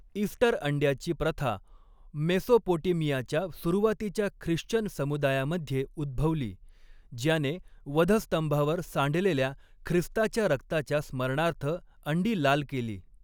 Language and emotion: Marathi, neutral